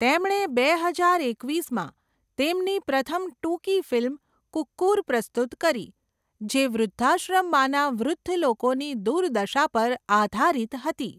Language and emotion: Gujarati, neutral